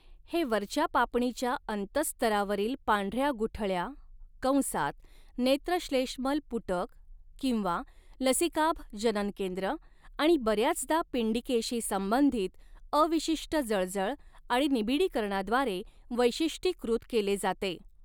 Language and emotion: Marathi, neutral